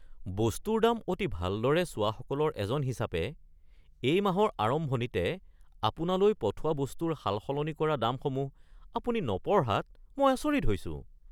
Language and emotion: Assamese, surprised